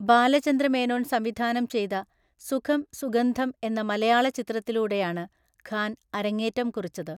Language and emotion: Malayalam, neutral